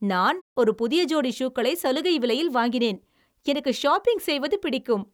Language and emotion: Tamil, happy